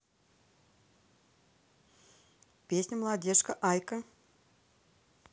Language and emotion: Russian, neutral